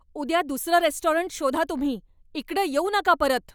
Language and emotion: Marathi, angry